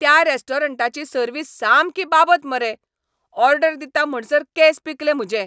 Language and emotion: Goan Konkani, angry